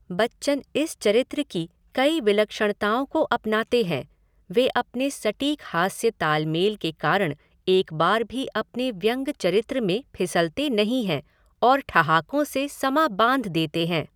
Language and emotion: Hindi, neutral